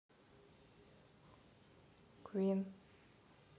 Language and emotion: Russian, neutral